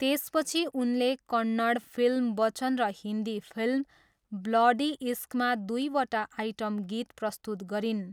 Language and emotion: Nepali, neutral